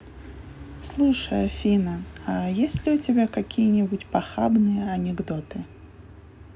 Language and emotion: Russian, neutral